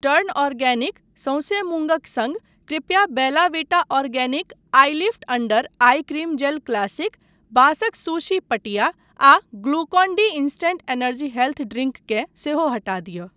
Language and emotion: Maithili, neutral